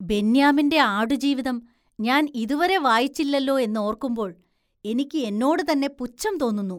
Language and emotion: Malayalam, disgusted